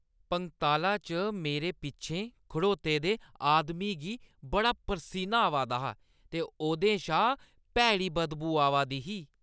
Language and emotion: Dogri, disgusted